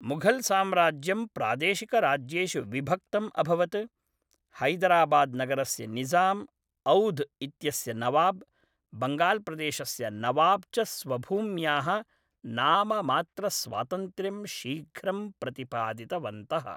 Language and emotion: Sanskrit, neutral